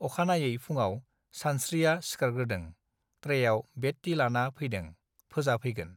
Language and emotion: Bodo, neutral